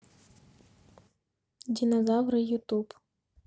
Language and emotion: Russian, neutral